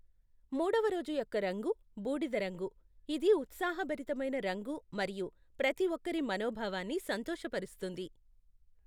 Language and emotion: Telugu, neutral